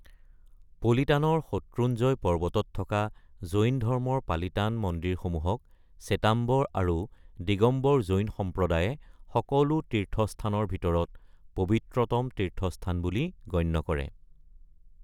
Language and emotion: Assamese, neutral